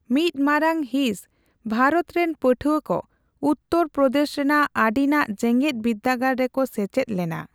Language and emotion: Santali, neutral